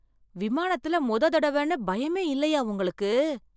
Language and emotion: Tamil, surprised